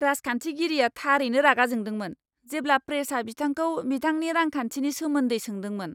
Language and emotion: Bodo, angry